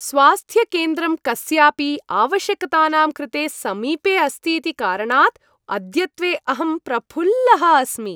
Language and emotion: Sanskrit, happy